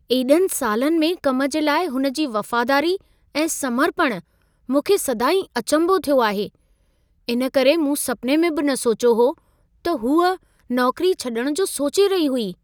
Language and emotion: Sindhi, surprised